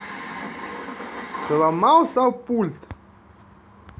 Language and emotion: Russian, neutral